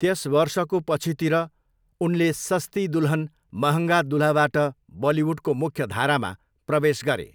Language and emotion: Nepali, neutral